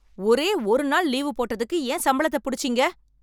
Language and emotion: Tamil, angry